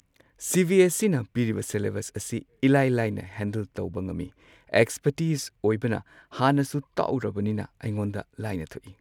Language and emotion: Manipuri, neutral